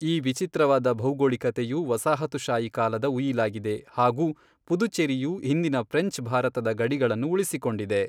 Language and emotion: Kannada, neutral